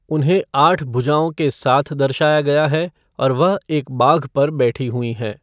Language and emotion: Hindi, neutral